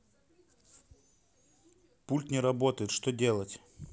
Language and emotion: Russian, neutral